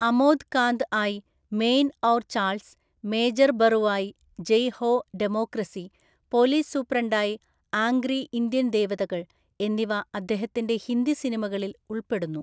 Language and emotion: Malayalam, neutral